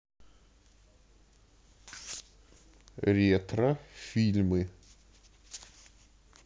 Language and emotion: Russian, neutral